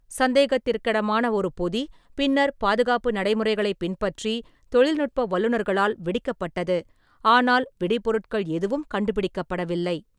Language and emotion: Tamil, neutral